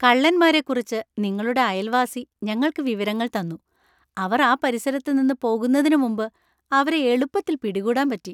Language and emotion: Malayalam, happy